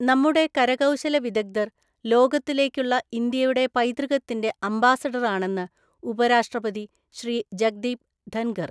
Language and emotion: Malayalam, neutral